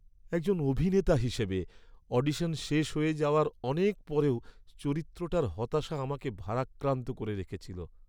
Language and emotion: Bengali, sad